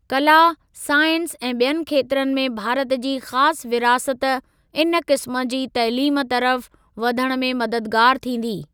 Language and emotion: Sindhi, neutral